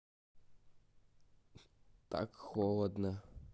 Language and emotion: Russian, sad